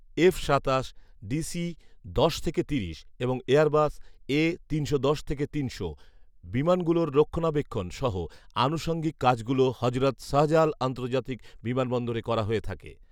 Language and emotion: Bengali, neutral